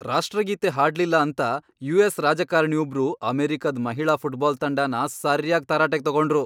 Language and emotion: Kannada, angry